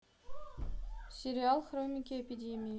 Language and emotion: Russian, neutral